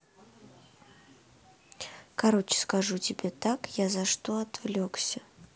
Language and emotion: Russian, neutral